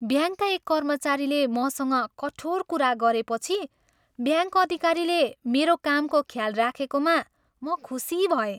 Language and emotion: Nepali, happy